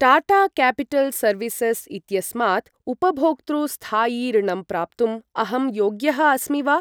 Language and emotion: Sanskrit, neutral